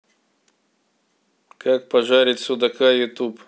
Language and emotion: Russian, neutral